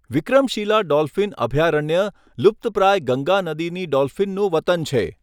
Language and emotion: Gujarati, neutral